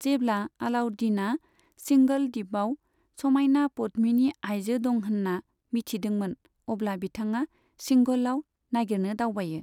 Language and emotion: Bodo, neutral